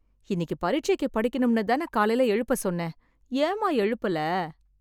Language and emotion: Tamil, sad